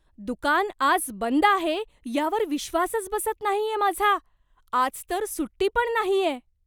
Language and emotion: Marathi, surprised